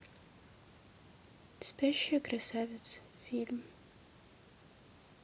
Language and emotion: Russian, neutral